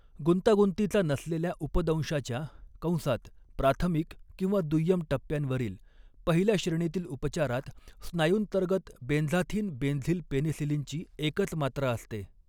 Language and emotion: Marathi, neutral